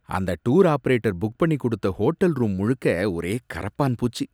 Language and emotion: Tamil, disgusted